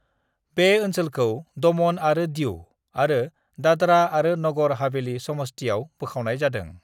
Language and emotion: Bodo, neutral